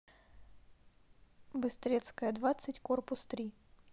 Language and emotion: Russian, neutral